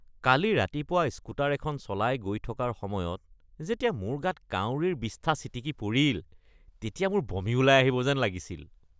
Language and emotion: Assamese, disgusted